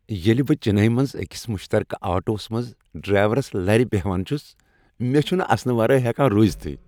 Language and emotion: Kashmiri, happy